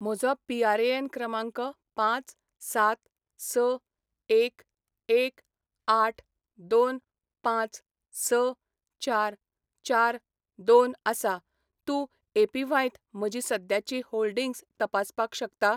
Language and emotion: Goan Konkani, neutral